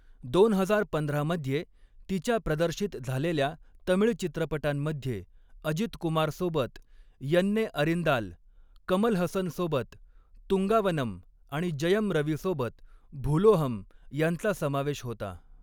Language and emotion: Marathi, neutral